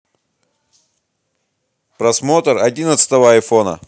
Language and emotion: Russian, neutral